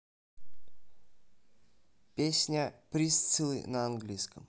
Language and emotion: Russian, neutral